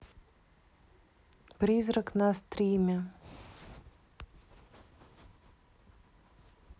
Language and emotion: Russian, neutral